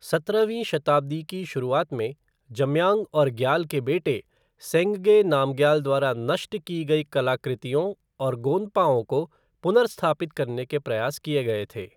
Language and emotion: Hindi, neutral